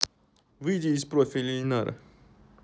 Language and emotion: Russian, neutral